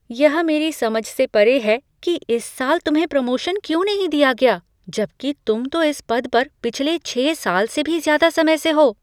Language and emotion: Hindi, surprised